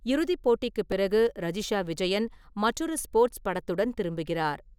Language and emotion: Tamil, neutral